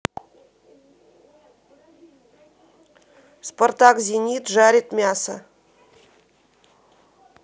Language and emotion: Russian, neutral